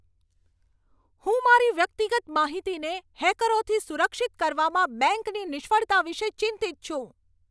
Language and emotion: Gujarati, angry